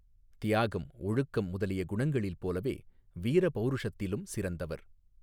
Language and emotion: Tamil, neutral